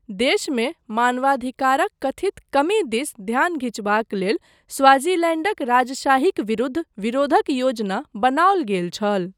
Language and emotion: Maithili, neutral